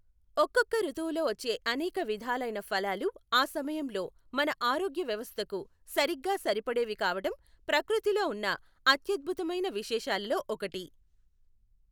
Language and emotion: Telugu, neutral